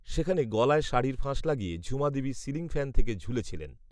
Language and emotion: Bengali, neutral